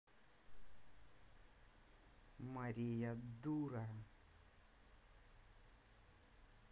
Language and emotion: Russian, angry